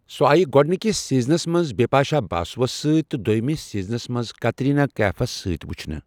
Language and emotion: Kashmiri, neutral